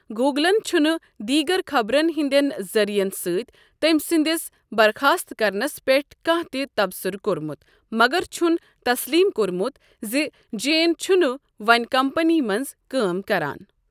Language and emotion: Kashmiri, neutral